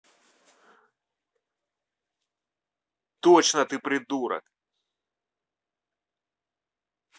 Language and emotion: Russian, angry